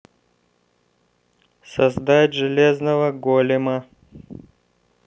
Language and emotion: Russian, neutral